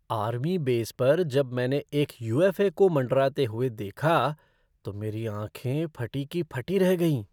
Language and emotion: Hindi, surprised